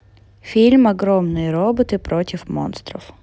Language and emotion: Russian, neutral